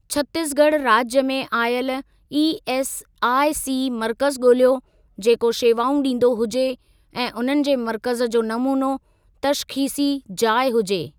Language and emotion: Sindhi, neutral